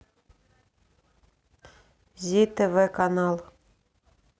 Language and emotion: Russian, neutral